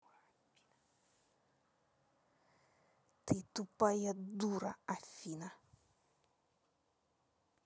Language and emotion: Russian, angry